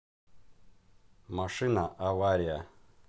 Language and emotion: Russian, neutral